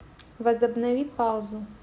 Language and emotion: Russian, neutral